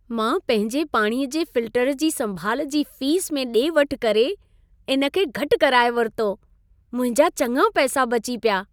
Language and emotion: Sindhi, happy